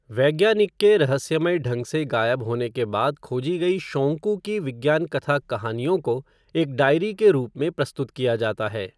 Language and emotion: Hindi, neutral